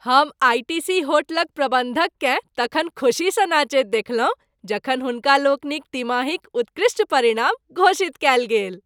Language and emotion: Maithili, happy